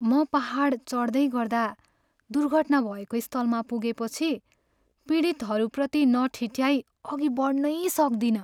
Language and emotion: Nepali, sad